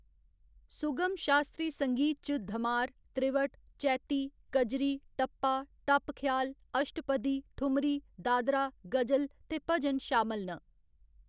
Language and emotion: Dogri, neutral